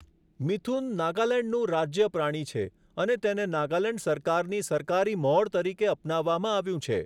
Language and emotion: Gujarati, neutral